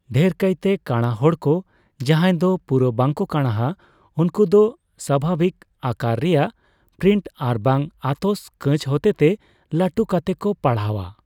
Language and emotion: Santali, neutral